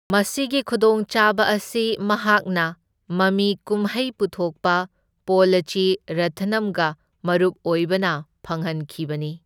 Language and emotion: Manipuri, neutral